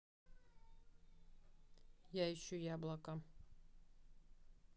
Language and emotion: Russian, neutral